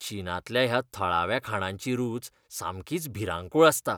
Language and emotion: Goan Konkani, disgusted